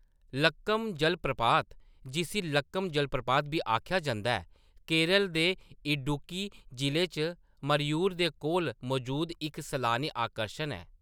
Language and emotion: Dogri, neutral